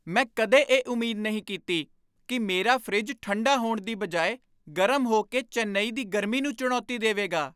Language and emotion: Punjabi, surprised